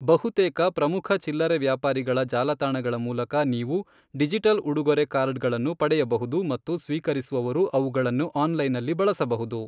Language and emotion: Kannada, neutral